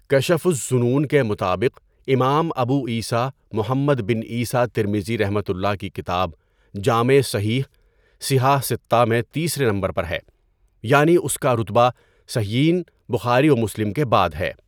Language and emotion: Urdu, neutral